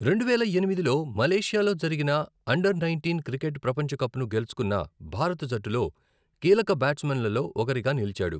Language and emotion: Telugu, neutral